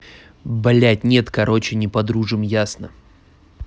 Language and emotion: Russian, angry